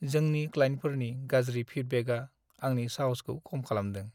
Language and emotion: Bodo, sad